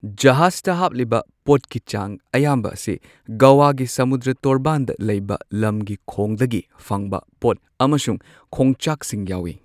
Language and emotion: Manipuri, neutral